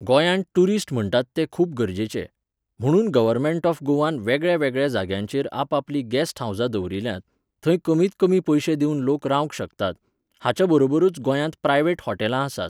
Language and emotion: Goan Konkani, neutral